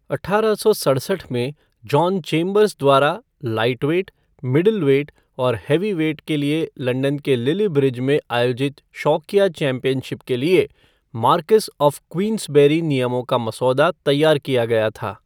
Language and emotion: Hindi, neutral